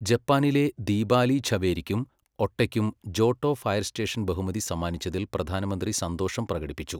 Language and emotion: Malayalam, neutral